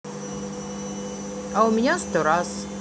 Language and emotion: Russian, neutral